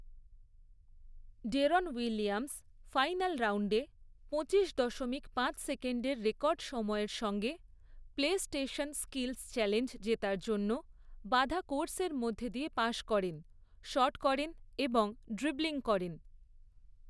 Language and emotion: Bengali, neutral